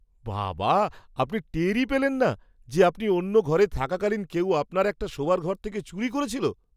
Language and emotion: Bengali, surprised